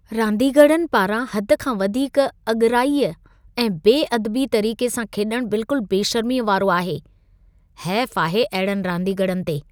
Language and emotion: Sindhi, disgusted